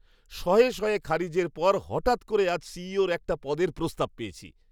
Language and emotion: Bengali, surprised